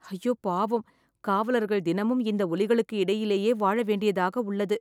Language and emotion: Tamil, sad